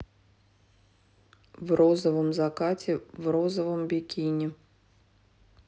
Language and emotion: Russian, neutral